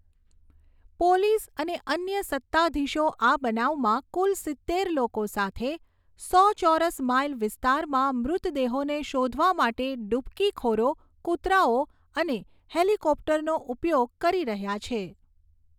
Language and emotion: Gujarati, neutral